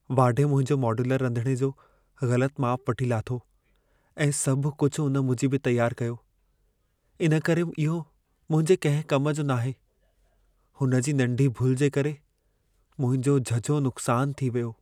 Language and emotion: Sindhi, sad